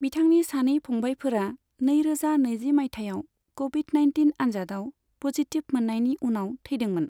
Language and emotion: Bodo, neutral